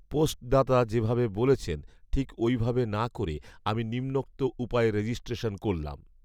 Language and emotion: Bengali, neutral